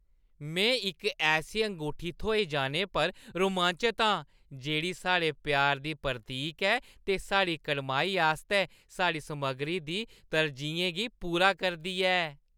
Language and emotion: Dogri, happy